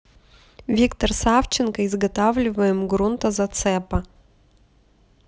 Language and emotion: Russian, neutral